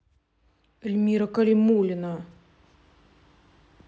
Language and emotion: Russian, neutral